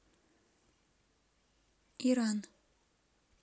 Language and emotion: Russian, neutral